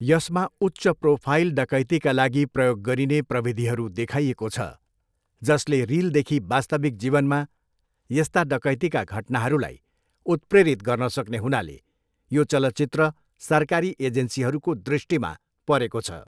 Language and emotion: Nepali, neutral